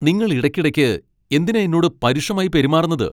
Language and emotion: Malayalam, angry